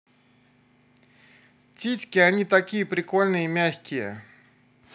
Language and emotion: Russian, positive